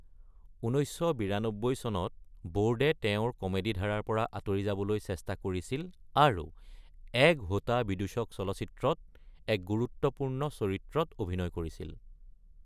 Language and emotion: Assamese, neutral